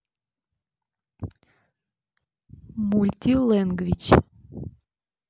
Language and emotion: Russian, neutral